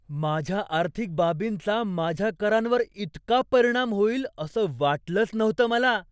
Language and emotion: Marathi, surprised